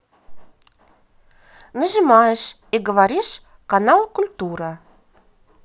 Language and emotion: Russian, positive